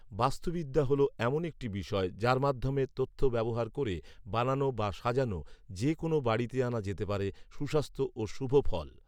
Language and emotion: Bengali, neutral